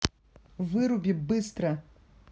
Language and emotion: Russian, angry